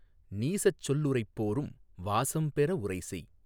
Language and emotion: Tamil, neutral